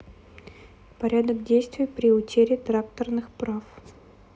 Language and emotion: Russian, neutral